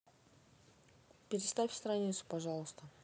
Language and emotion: Russian, neutral